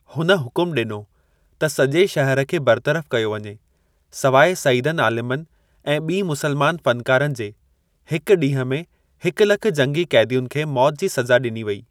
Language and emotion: Sindhi, neutral